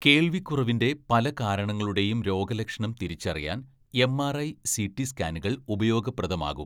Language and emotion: Malayalam, neutral